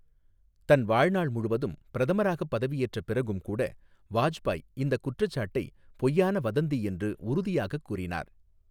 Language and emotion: Tamil, neutral